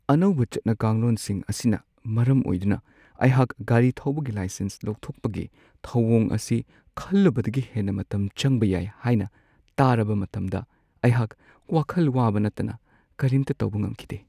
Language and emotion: Manipuri, sad